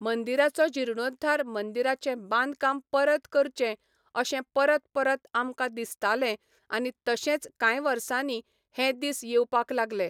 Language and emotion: Goan Konkani, neutral